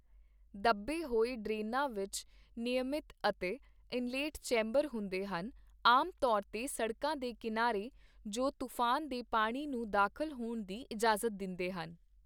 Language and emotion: Punjabi, neutral